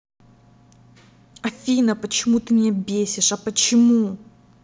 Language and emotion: Russian, angry